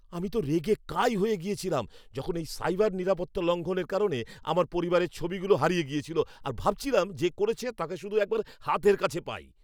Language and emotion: Bengali, angry